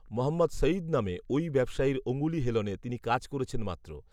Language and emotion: Bengali, neutral